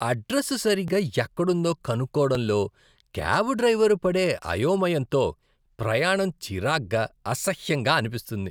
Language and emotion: Telugu, disgusted